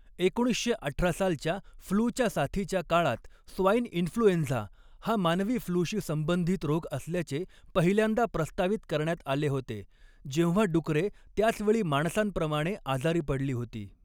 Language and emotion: Marathi, neutral